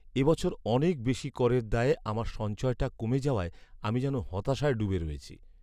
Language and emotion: Bengali, sad